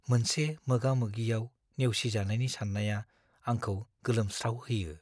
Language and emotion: Bodo, fearful